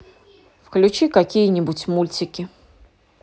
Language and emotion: Russian, neutral